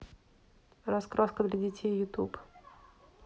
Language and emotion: Russian, neutral